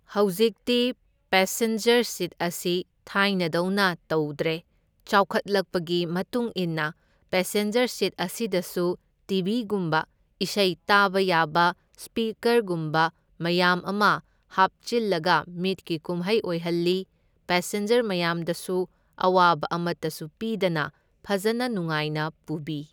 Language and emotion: Manipuri, neutral